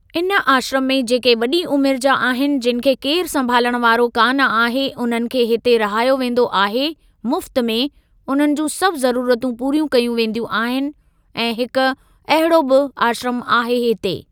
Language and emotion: Sindhi, neutral